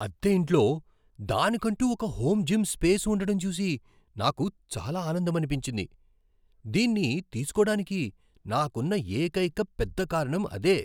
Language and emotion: Telugu, surprised